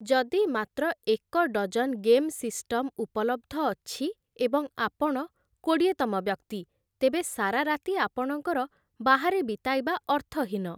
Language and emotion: Odia, neutral